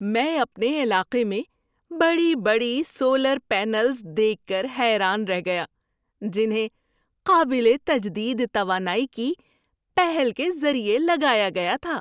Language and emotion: Urdu, surprised